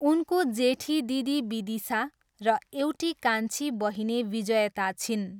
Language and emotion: Nepali, neutral